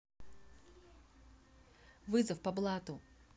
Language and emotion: Russian, neutral